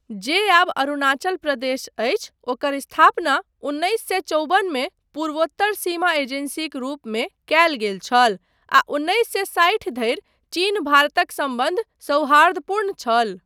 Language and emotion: Maithili, neutral